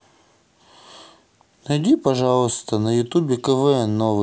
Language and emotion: Russian, neutral